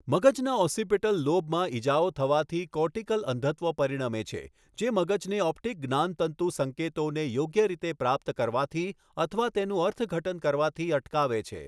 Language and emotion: Gujarati, neutral